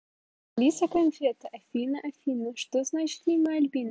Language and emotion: Russian, positive